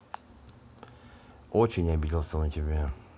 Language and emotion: Russian, neutral